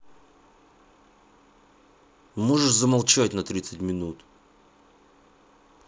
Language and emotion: Russian, angry